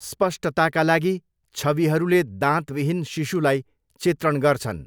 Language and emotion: Nepali, neutral